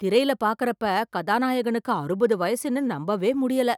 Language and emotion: Tamil, surprised